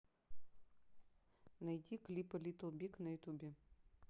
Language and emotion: Russian, neutral